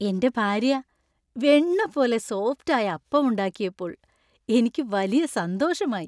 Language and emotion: Malayalam, happy